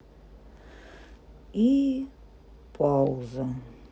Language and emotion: Russian, sad